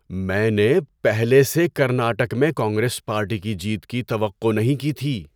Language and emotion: Urdu, surprised